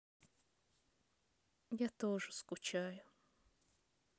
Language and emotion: Russian, sad